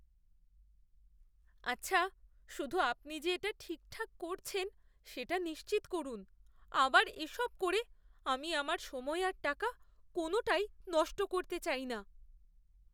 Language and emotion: Bengali, fearful